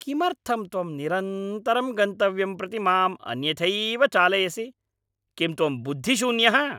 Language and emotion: Sanskrit, angry